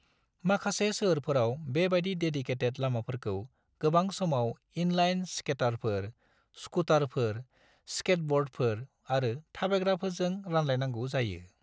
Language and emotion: Bodo, neutral